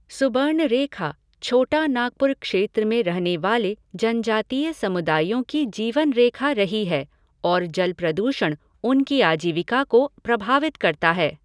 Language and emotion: Hindi, neutral